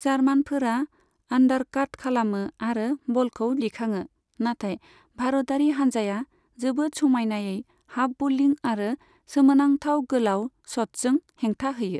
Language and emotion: Bodo, neutral